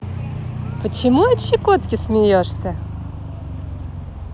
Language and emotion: Russian, positive